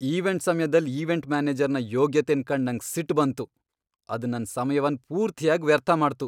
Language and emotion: Kannada, angry